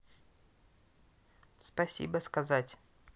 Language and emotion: Russian, neutral